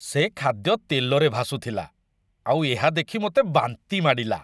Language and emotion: Odia, disgusted